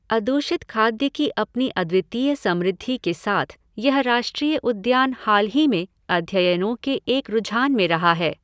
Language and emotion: Hindi, neutral